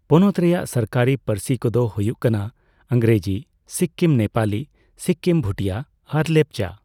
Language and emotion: Santali, neutral